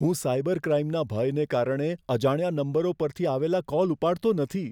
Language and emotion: Gujarati, fearful